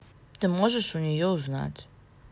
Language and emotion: Russian, neutral